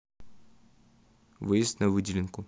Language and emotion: Russian, neutral